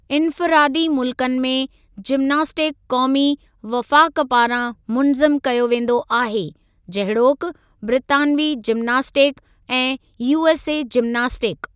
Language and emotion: Sindhi, neutral